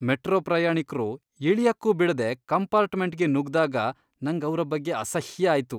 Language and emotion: Kannada, disgusted